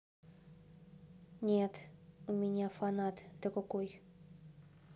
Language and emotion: Russian, neutral